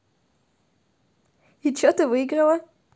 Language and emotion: Russian, positive